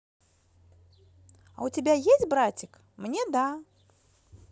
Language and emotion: Russian, positive